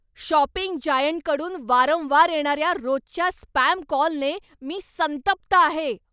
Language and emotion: Marathi, angry